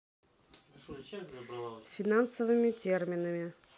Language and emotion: Russian, neutral